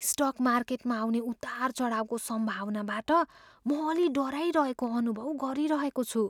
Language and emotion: Nepali, fearful